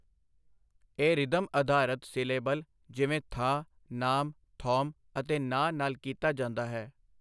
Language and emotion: Punjabi, neutral